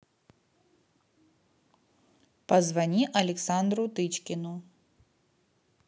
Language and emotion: Russian, neutral